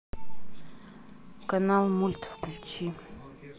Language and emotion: Russian, neutral